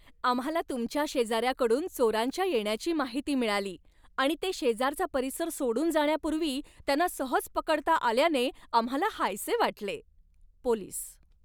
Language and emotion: Marathi, happy